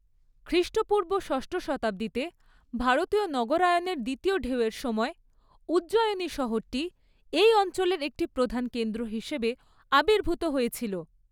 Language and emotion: Bengali, neutral